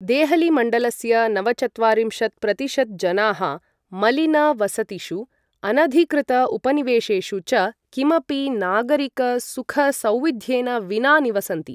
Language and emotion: Sanskrit, neutral